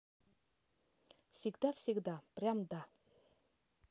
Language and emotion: Russian, neutral